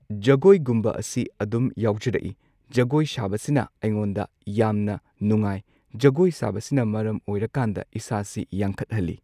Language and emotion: Manipuri, neutral